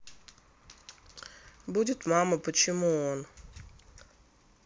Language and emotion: Russian, neutral